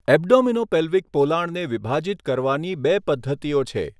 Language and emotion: Gujarati, neutral